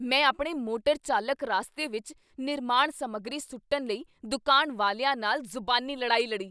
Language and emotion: Punjabi, angry